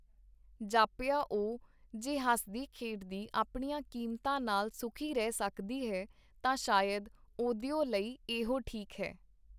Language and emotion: Punjabi, neutral